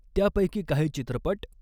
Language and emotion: Marathi, neutral